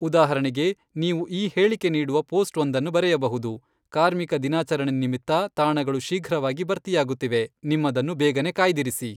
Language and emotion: Kannada, neutral